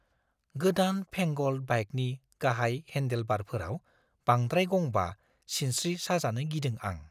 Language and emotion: Bodo, fearful